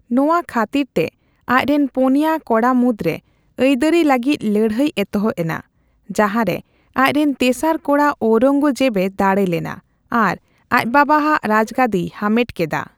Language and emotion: Santali, neutral